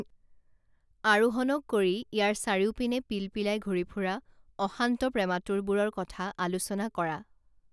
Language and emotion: Assamese, neutral